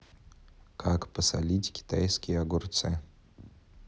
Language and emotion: Russian, neutral